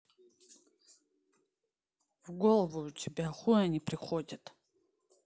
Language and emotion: Russian, angry